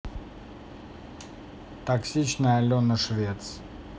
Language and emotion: Russian, neutral